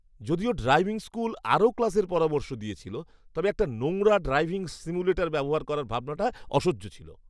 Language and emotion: Bengali, disgusted